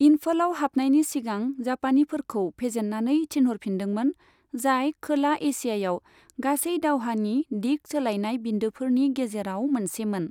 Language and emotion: Bodo, neutral